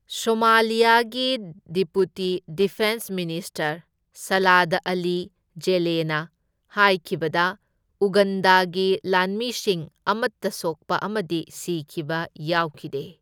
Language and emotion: Manipuri, neutral